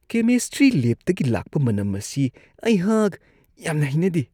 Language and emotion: Manipuri, disgusted